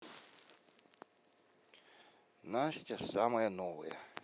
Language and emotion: Russian, neutral